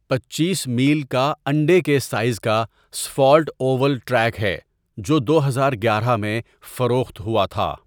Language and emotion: Urdu, neutral